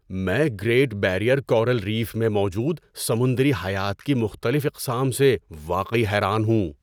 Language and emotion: Urdu, surprised